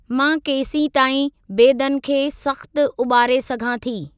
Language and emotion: Sindhi, neutral